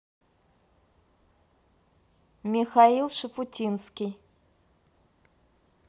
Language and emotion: Russian, neutral